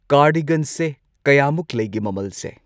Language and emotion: Manipuri, neutral